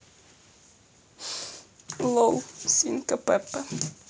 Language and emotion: Russian, sad